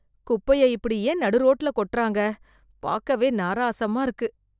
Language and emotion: Tamil, disgusted